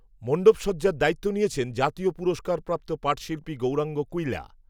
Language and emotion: Bengali, neutral